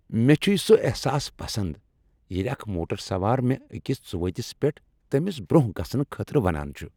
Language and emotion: Kashmiri, happy